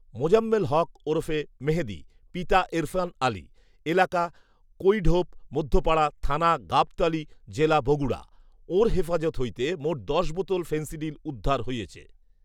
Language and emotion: Bengali, neutral